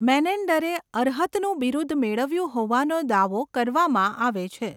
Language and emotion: Gujarati, neutral